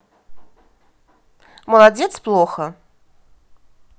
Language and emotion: Russian, angry